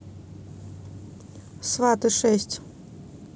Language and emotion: Russian, neutral